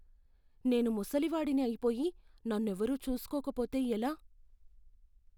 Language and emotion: Telugu, fearful